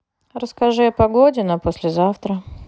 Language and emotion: Russian, neutral